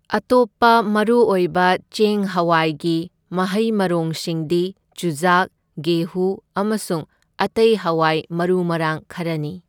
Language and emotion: Manipuri, neutral